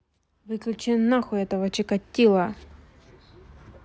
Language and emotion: Russian, angry